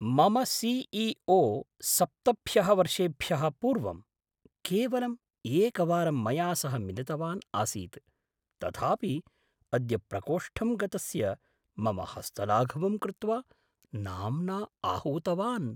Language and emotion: Sanskrit, surprised